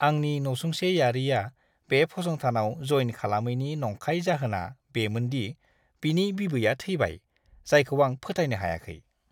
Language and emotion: Bodo, disgusted